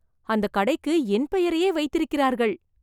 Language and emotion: Tamil, surprised